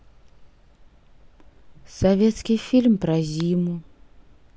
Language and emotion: Russian, sad